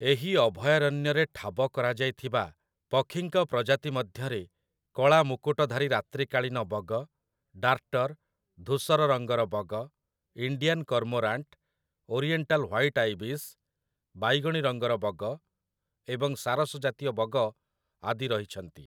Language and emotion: Odia, neutral